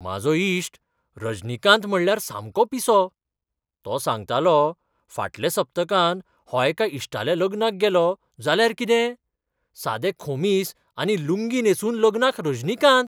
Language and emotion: Goan Konkani, surprised